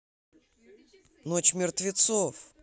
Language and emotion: Russian, neutral